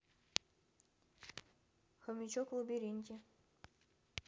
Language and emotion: Russian, neutral